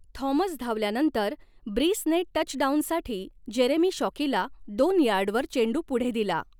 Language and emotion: Marathi, neutral